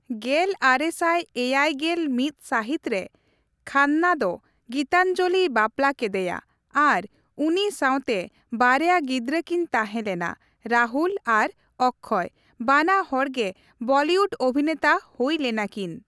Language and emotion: Santali, neutral